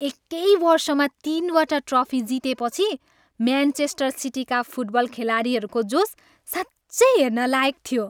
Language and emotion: Nepali, happy